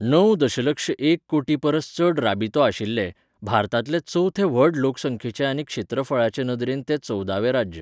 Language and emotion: Goan Konkani, neutral